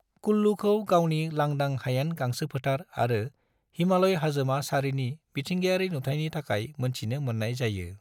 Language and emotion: Bodo, neutral